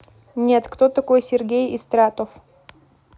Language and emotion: Russian, neutral